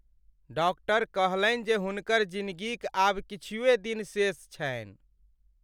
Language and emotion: Maithili, sad